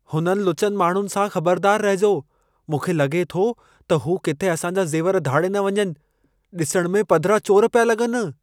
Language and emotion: Sindhi, fearful